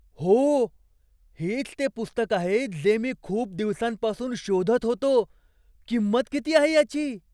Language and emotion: Marathi, surprised